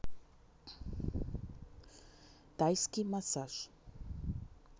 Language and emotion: Russian, neutral